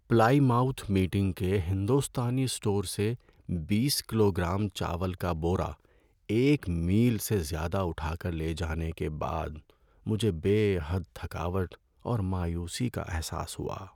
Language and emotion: Urdu, sad